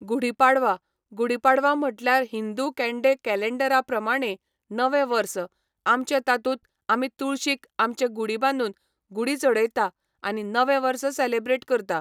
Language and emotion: Goan Konkani, neutral